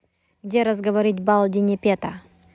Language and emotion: Russian, neutral